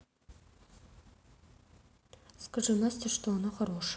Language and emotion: Russian, neutral